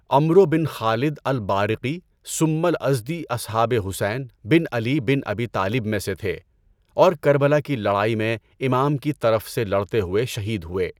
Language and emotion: Urdu, neutral